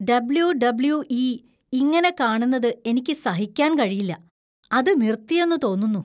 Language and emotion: Malayalam, disgusted